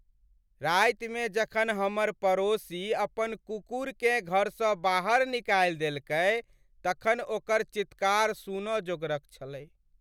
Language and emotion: Maithili, sad